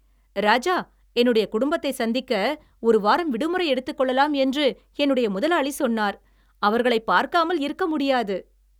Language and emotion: Tamil, happy